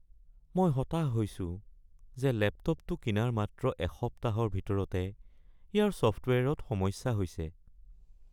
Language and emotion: Assamese, sad